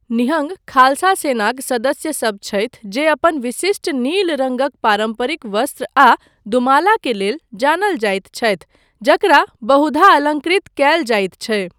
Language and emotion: Maithili, neutral